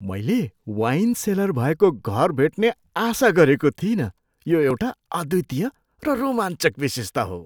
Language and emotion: Nepali, surprised